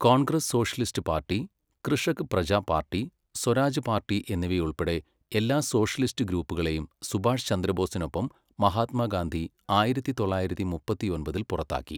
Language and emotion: Malayalam, neutral